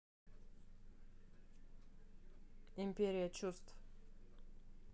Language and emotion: Russian, neutral